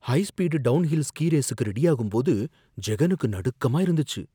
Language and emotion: Tamil, fearful